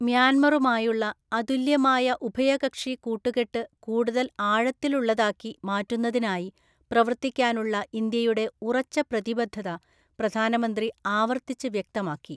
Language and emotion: Malayalam, neutral